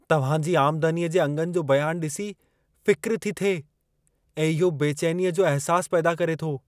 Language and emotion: Sindhi, fearful